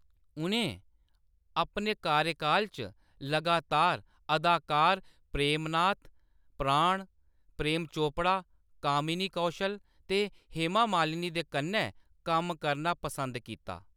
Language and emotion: Dogri, neutral